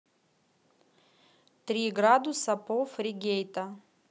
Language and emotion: Russian, neutral